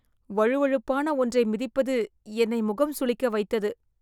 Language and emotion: Tamil, disgusted